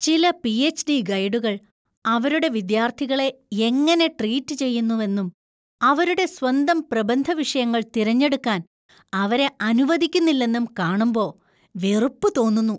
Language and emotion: Malayalam, disgusted